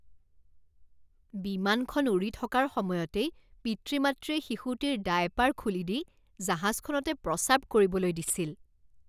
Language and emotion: Assamese, disgusted